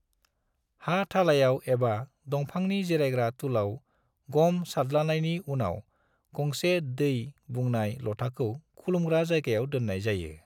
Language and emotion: Bodo, neutral